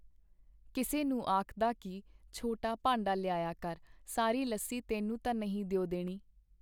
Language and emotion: Punjabi, neutral